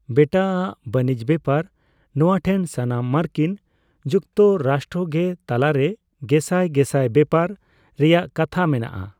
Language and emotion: Santali, neutral